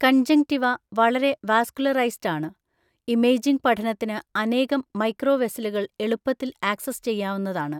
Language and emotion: Malayalam, neutral